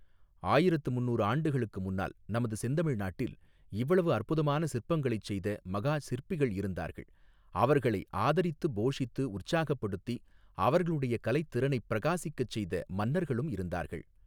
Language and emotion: Tamil, neutral